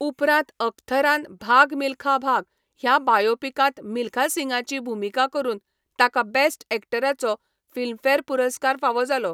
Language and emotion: Goan Konkani, neutral